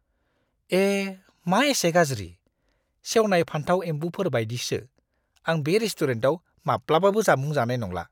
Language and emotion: Bodo, disgusted